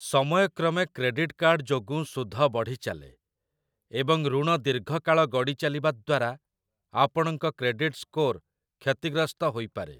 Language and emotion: Odia, neutral